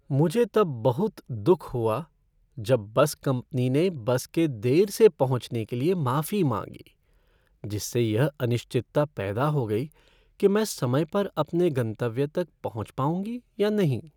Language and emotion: Hindi, sad